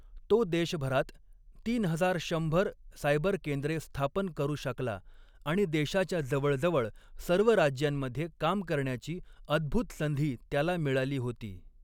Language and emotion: Marathi, neutral